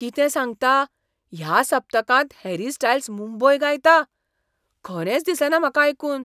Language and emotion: Goan Konkani, surprised